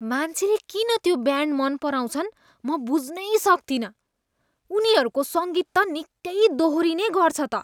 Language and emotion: Nepali, disgusted